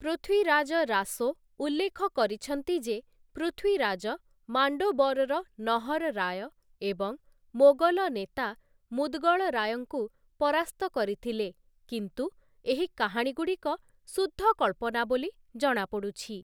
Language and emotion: Odia, neutral